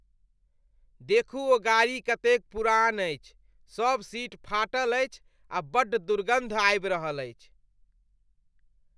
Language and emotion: Maithili, disgusted